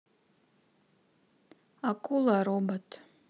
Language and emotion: Russian, neutral